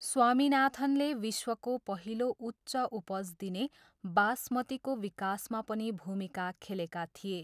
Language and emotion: Nepali, neutral